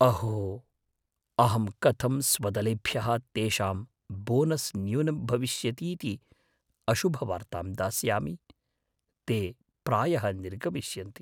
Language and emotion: Sanskrit, fearful